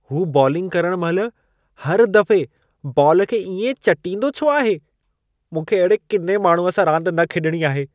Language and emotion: Sindhi, disgusted